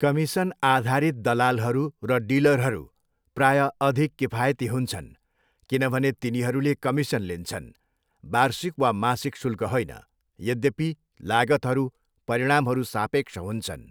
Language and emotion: Nepali, neutral